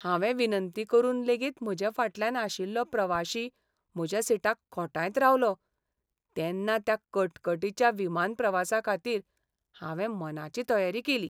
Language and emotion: Goan Konkani, sad